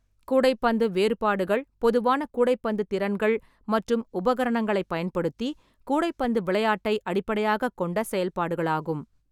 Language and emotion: Tamil, neutral